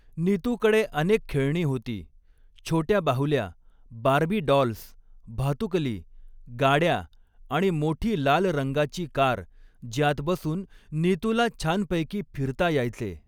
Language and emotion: Marathi, neutral